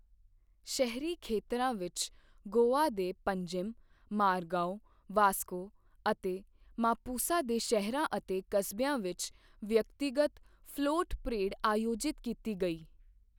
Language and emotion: Punjabi, neutral